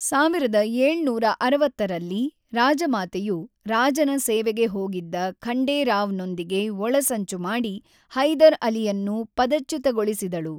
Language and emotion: Kannada, neutral